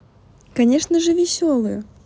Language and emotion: Russian, positive